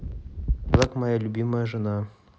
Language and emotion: Russian, neutral